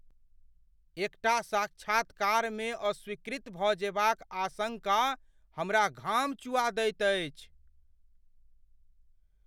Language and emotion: Maithili, fearful